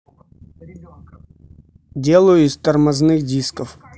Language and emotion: Russian, neutral